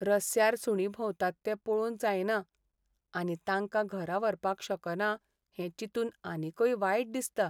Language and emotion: Goan Konkani, sad